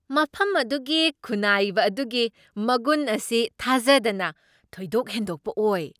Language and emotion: Manipuri, surprised